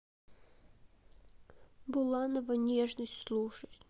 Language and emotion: Russian, sad